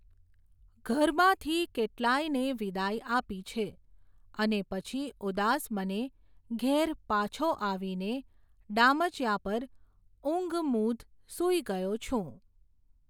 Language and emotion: Gujarati, neutral